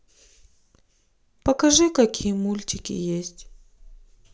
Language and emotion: Russian, sad